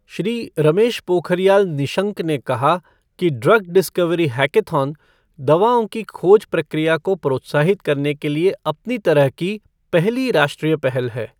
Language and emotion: Hindi, neutral